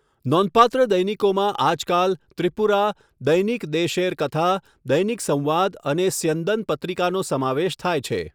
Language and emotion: Gujarati, neutral